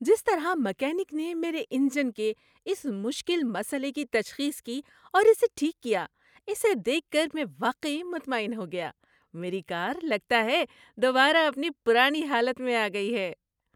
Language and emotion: Urdu, happy